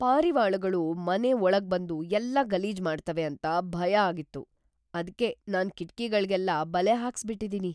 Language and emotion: Kannada, fearful